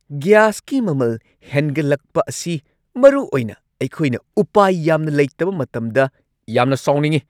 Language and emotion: Manipuri, angry